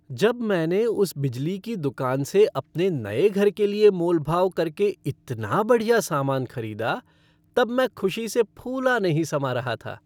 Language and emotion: Hindi, happy